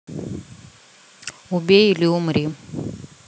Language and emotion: Russian, neutral